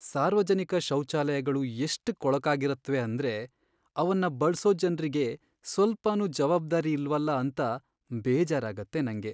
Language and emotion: Kannada, sad